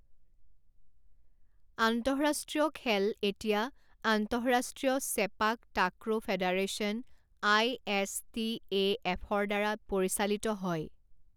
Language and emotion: Assamese, neutral